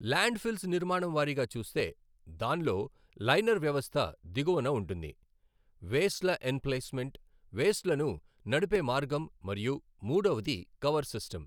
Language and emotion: Telugu, neutral